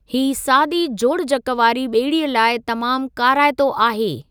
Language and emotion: Sindhi, neutral